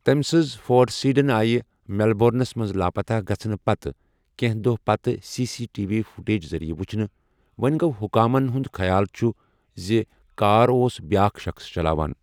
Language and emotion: Kashmiri, neutral